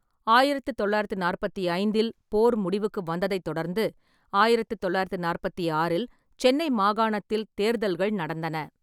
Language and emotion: Tamil, neutral